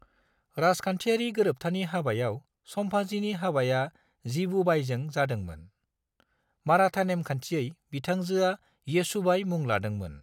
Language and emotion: Bodo, neutral